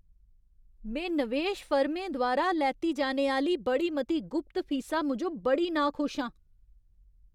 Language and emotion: Dogri, angry